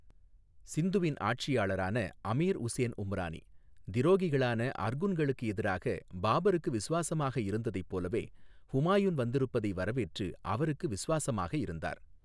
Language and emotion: Tamil, neutral